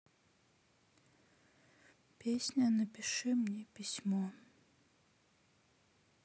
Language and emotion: Russian, sad